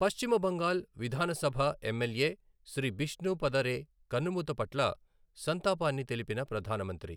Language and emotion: Telugu, neutral